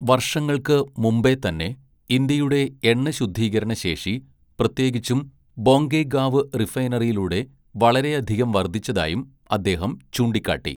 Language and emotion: Malayalam, neutral